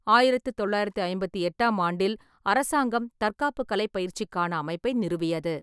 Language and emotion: Tamil, neutral